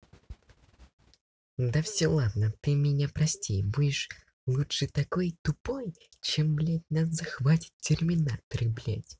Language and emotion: Russian, angry